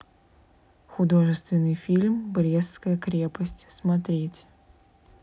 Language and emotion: Russian, neutral